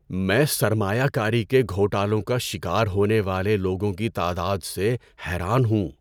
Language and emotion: Urdu, surprised